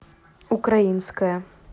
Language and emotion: Russian, neutral